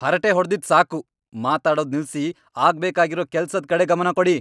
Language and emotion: Kannada, angry